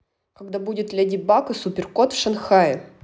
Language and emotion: Russian, neutral